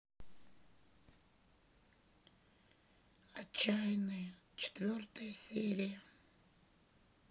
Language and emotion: Russian, sad